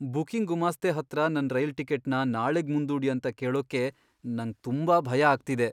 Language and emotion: Kannada, fearful